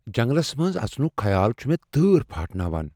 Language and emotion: Kashmiri, fearful